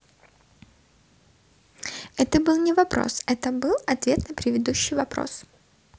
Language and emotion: Russian, positive